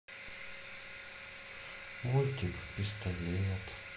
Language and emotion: Russian, sad